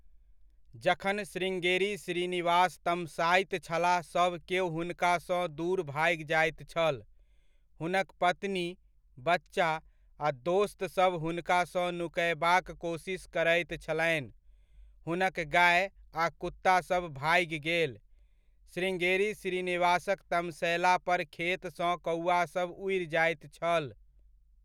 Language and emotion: Maithili, neutral